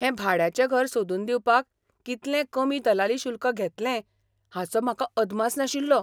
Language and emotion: Goan Konkani, surprised